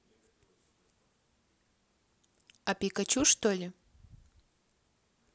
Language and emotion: Russian, neutral